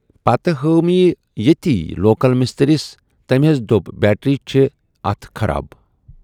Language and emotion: Kashmiri, neutral